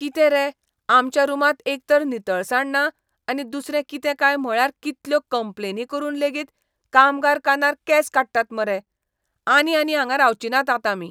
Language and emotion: Goan Konkani, disgusted